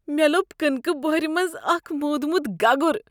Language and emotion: Kashmiri, disgusted